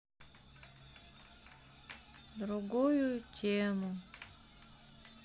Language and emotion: Russian, sad